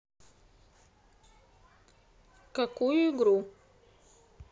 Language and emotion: Russian, neutral